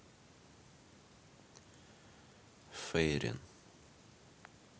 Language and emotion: Russian, neutral